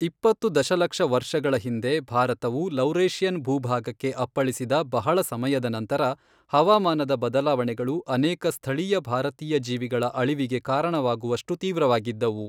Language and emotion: Kannada, neutral